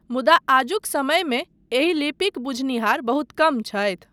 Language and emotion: Maithili, neutral